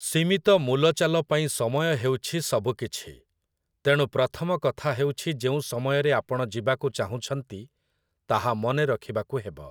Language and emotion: Odia, neutral